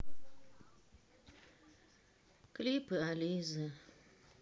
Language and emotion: Russian, sad